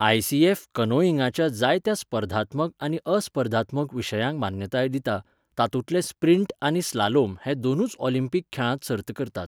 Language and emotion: Goan Konkani, neutral